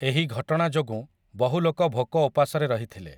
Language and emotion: Odia, neutral